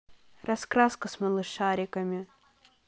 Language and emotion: Russian, neutral